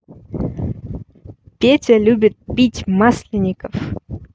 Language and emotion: Russian, neutral